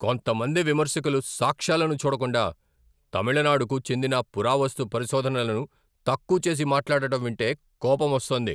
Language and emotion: Telugu, angry